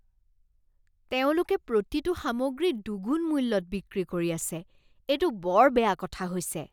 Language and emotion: Assamese, disgusted